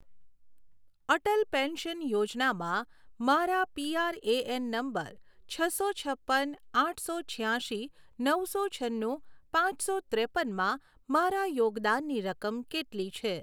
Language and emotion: Gujarati, neutral